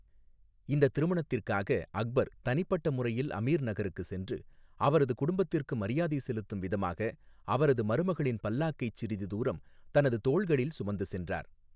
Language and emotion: Tamil, neutral